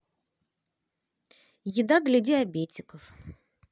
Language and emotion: Russian, neutral